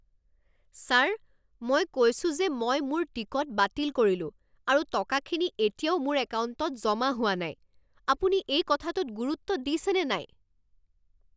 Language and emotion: Assamese, angry